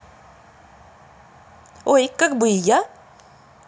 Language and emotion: Russian, positive